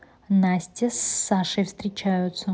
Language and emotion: Russian, neutral